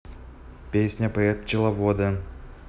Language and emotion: Russian, neutral